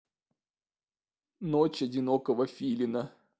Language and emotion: Russian, sad